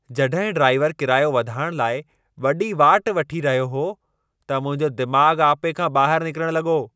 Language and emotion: Sindhi, angry